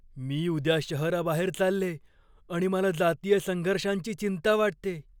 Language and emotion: Marathi, fearful